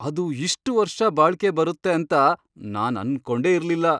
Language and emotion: Kannada, surprised